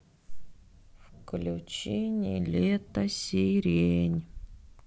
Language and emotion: Russian, sad